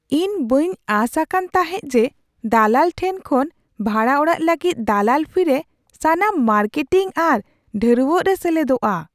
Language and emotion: Santali, surprised